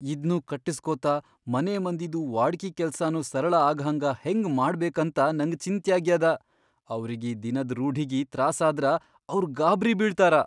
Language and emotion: Kannada, fearful